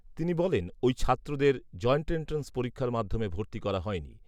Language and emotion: Bengali, neutral